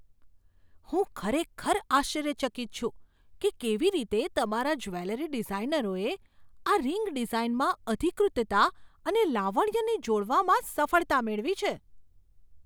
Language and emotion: Gujarati, surprised